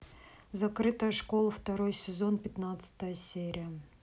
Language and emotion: Russian, neutral